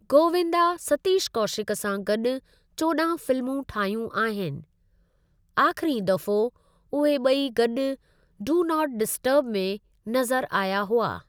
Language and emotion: Sindhi, neutral